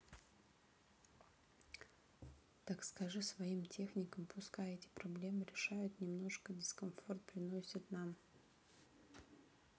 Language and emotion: Russian, neutral